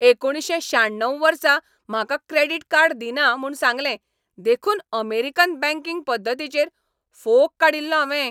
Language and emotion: Goan Konkani, angry